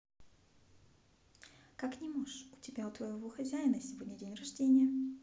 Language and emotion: Russian, neutral